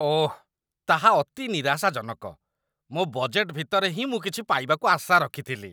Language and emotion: Odia, disgusted